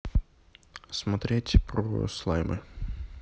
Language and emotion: Russian, neutral